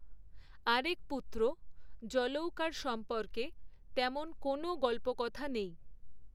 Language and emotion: Bengali, neutral